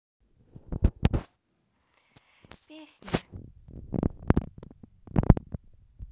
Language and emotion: Russian, sad